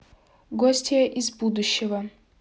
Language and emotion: Russian, neutral